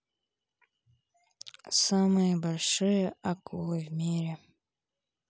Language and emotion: Russian, neutral